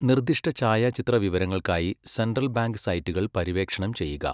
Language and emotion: Malayalam, neutral